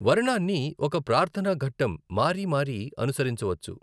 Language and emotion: Telugu, neutral